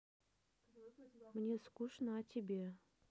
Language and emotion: Russian, neutral